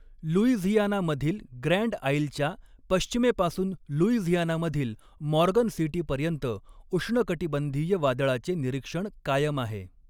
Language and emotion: Marathi, neutral